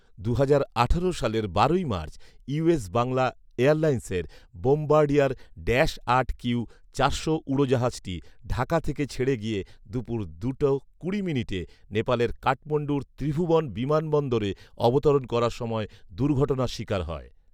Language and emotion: Bengali, neutral